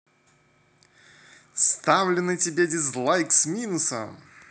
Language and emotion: Russian, positive